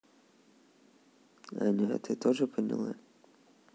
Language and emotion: Russian, neutral